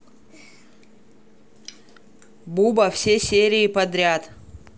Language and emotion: Russian, neutral